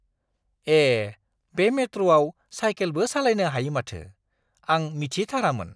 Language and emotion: Bodo, surprised